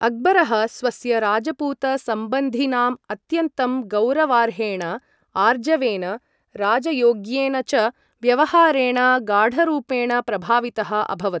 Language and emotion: Sanskrit, neutral